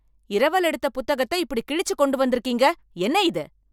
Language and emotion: Tamil, angry